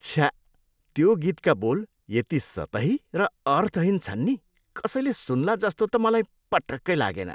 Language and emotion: Nepali, disgusted